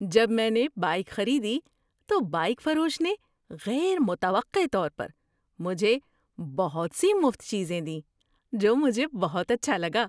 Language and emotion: Urdu, surprised